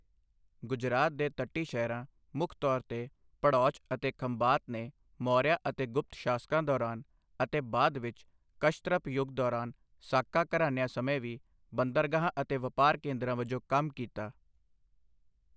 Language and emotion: Punjabi, neutral